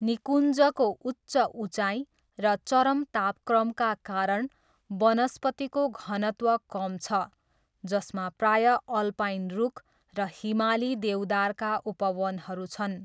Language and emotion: Nepali, neutral